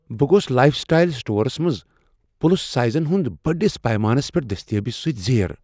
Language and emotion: Kashmiri, surprised